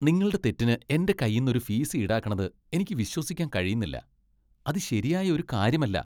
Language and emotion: Malayalam, disgusted